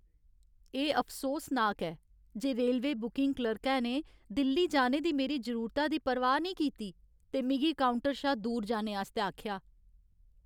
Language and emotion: Dogri, sad